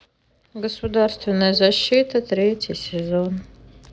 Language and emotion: Russian, neutral